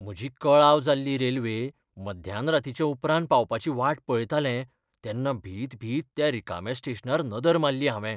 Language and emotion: Goan Konkani, fearful